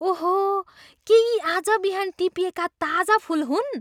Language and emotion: Nepali, surprised